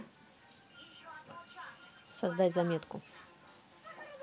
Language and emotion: Russian, neutral